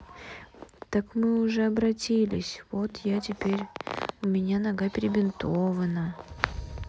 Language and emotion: Russian, sad